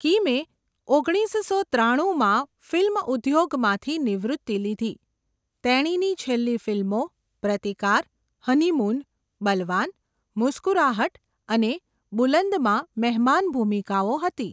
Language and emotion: Gujarati, neutral